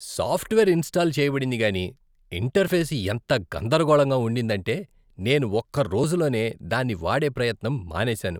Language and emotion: Telugu, disgusted